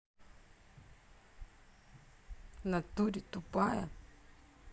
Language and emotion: Russian, angry